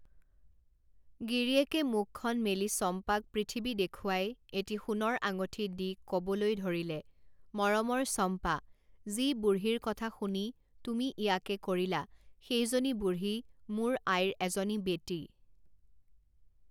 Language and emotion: Assamese, neutral